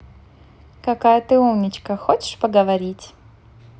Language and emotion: Russian, positive